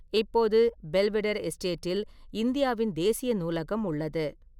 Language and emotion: Tamil, neutral